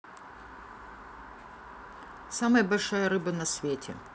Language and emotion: Russian, neutral